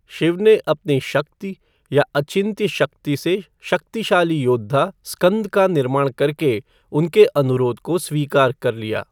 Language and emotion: Hindi, neutral